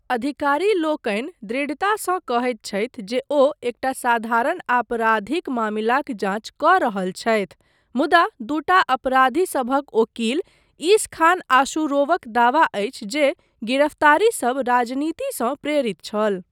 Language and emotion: Maithili, neutral